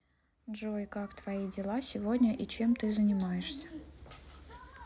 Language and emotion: Russian, neutral